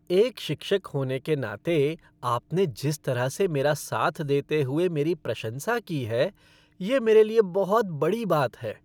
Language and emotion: Hindi, happy